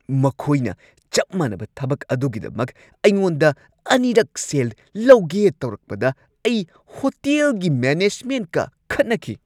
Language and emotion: Manipuri, angry